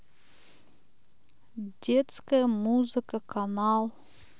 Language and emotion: Russian, neutral